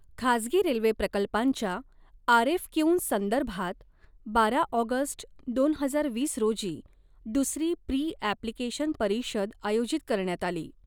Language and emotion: Marathi, neutral